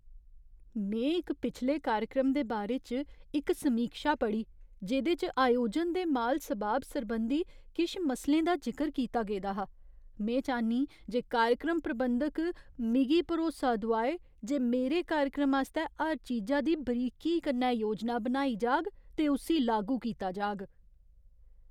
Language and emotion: Dogri, fearful